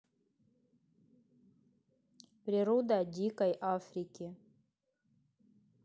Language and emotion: Russian, neutral